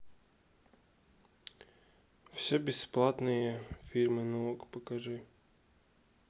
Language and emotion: Russian, neutral